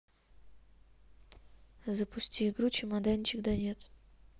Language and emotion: Russian, neutral